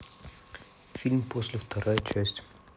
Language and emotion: Russian, neutral